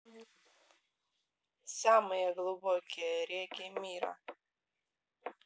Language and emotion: Russian, neutral